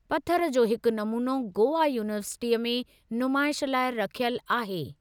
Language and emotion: Sindhi, neutral